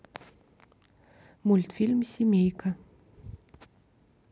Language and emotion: Russian, neutral